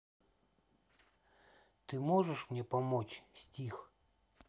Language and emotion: Russian, neutral